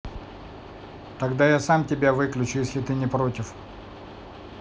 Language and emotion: Russian, neutral